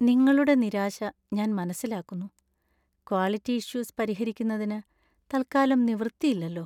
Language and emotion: Malayalam, sad